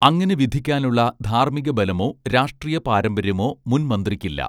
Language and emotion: Malayalam, neutral